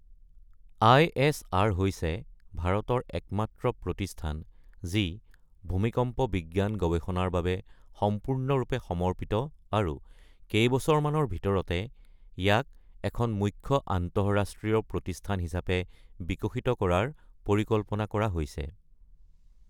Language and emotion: Assamese, neutral